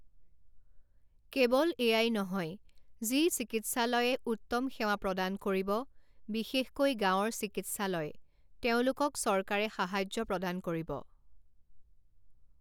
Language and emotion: Assamese, neutral